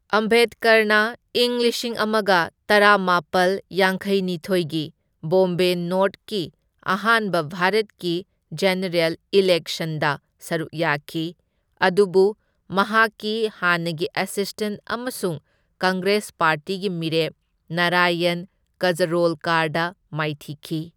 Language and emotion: Manipuri, neutral